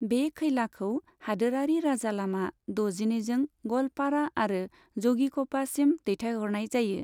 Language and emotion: Bodo, neutral